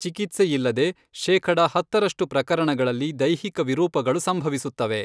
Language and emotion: Kannada, neutral